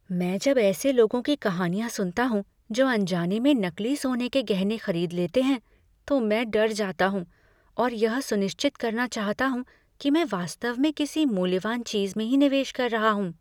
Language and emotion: Hindi, fearful